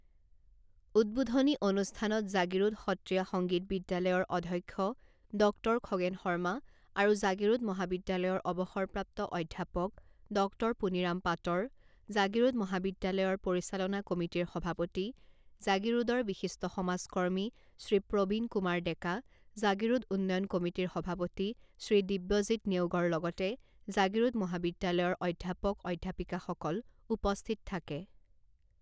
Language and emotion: Assamese, neutral